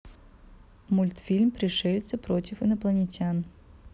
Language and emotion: Russian, neutral